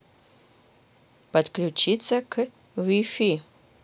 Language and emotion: Russian, neutral